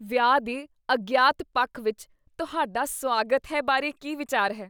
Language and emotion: Punjabi, disgusted